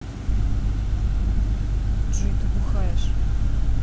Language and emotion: Russian, neutral